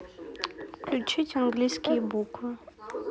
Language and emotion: Russian, neutral